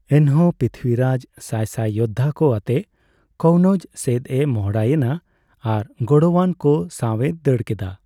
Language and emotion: Santali, neutral